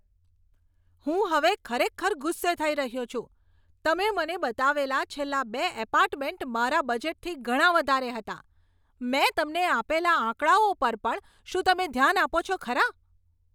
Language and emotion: Gujarati, angry